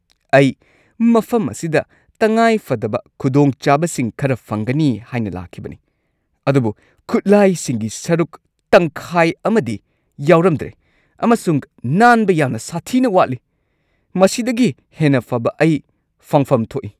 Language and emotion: Manipuri, angry